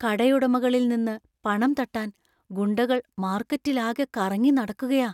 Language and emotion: Malayalam, fearful